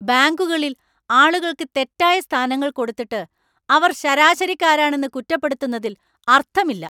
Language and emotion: Malayalam, angry